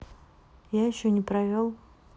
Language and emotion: Russian, neutral